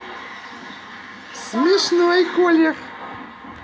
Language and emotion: Russian, positive